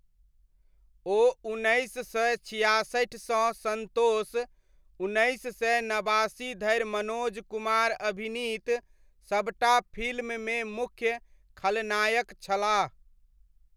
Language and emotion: Maithili, neutral